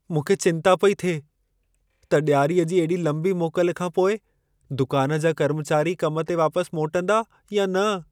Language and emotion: Sindhi, fearful